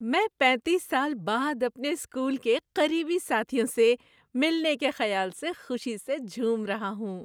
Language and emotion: Urdu, happy